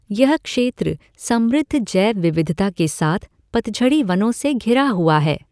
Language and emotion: Hindi, neutral